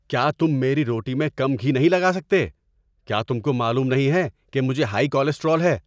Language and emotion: Urdu, angry